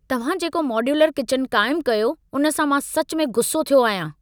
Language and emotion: Sindhi, angry